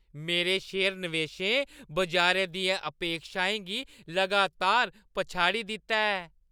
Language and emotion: Dogri, happy